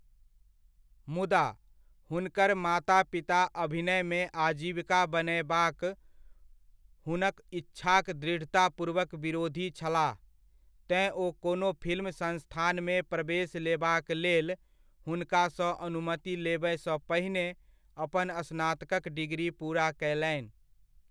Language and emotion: Maithili, neutral